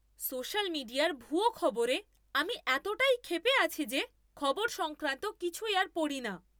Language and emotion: Bengali, angry